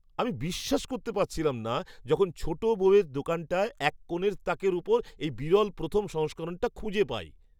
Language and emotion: Bengali, surprised